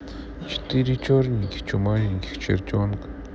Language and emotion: Russian, sad